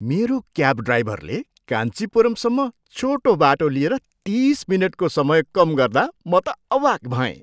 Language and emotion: Nepali, surprised